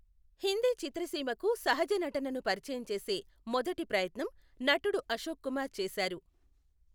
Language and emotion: Telugu, neutral